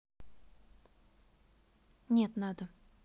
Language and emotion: Russian, neutral